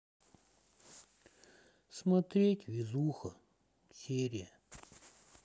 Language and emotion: Russian, sad